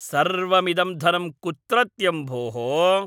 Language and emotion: Sanskrit, angry